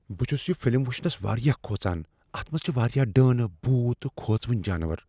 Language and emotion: Kashmiri, fearful